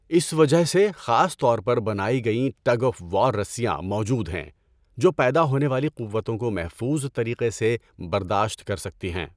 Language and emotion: Urdu, neutral